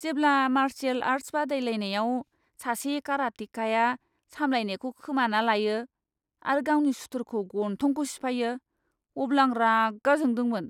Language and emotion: Bodo, disgusted